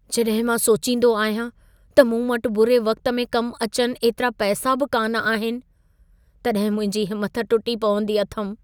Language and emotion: Sindhi, sad